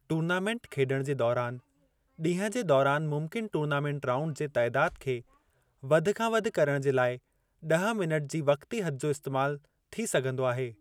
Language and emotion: Sindhi, neutral